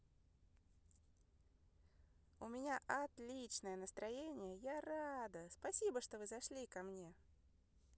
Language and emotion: Russian, positive